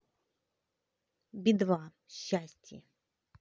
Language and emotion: Russian, positive